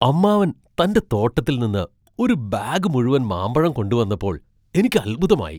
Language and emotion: Malayalam, surprised